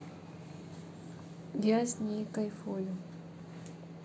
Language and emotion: Russian, neutral